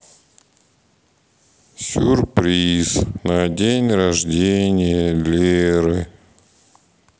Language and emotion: Russian, sad